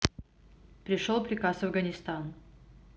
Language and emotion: Russian, neutral